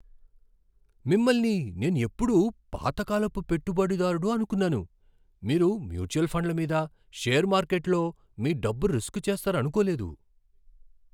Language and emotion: Telugu, surprised